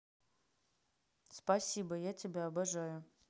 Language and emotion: Russian, neutral